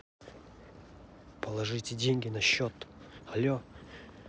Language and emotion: Russian, neutral